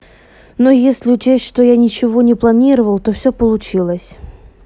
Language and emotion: Russian, neutral